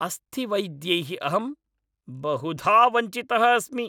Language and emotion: Sanskrit, angry